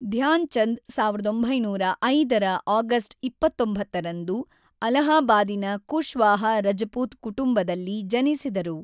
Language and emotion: Kannada, neutral